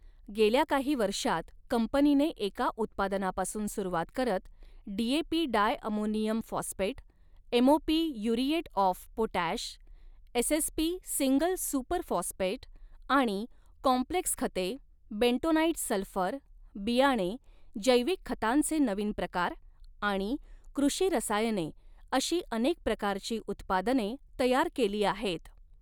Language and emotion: Marathi, neutral